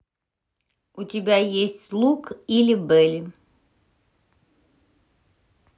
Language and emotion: Russian, neutral